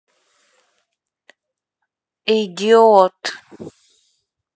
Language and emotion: Russian, neutral